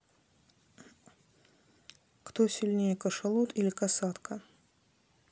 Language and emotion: Russian, neutral